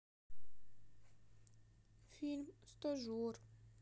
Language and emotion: Russian, sad